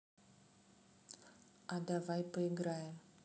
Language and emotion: Russian, neutral